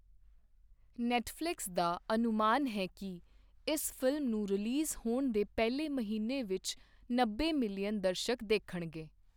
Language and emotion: Punjabi, neutral